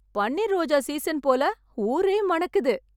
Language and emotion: Tamil, happy